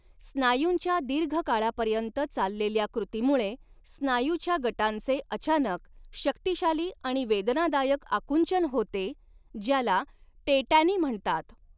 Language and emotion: Marathi, neutral